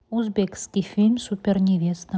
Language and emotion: Russian, neutral